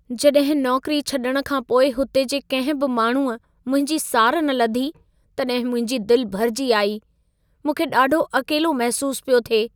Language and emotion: Sindhi, sad